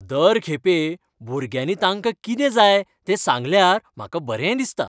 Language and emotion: Goan Konkani, happy